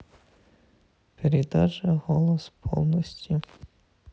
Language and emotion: Russian, sad